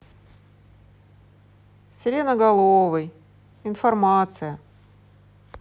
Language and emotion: Russian, neutral